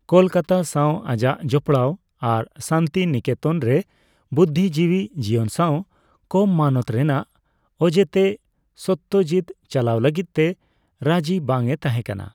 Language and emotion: Santali, neutral